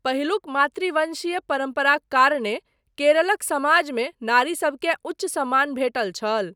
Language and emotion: Maithili, neutral